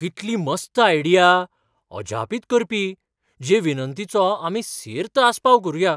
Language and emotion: Goan Konkani, surprised